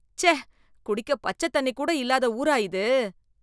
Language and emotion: Tamil, disgusted